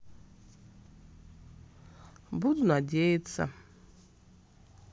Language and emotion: Russian, sad